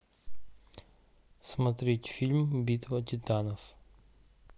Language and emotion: Russian, neutral